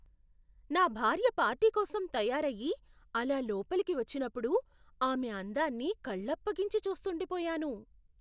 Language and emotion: Telugu, surprised